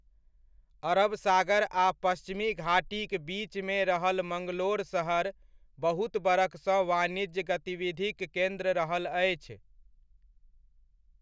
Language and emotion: Maithili, neutral